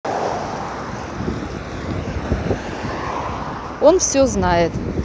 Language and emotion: Russian, neutral